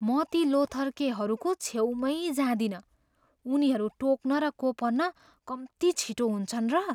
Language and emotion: Nepali, fearful